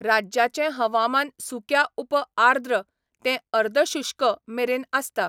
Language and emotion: Goan Konkani, neutral